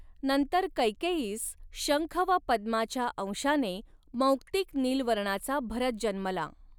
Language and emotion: Marathi, neutral